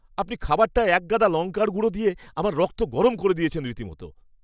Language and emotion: Bengali, angry